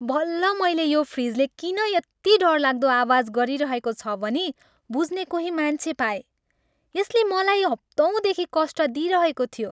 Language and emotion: Nepali, happy